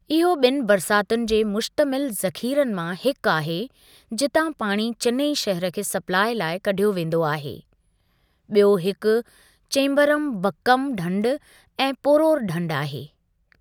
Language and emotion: Sindhi, neutral